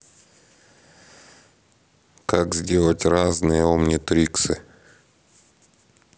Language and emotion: Russian, neutral